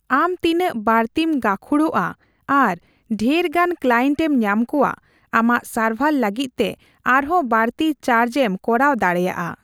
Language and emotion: Santali, neutral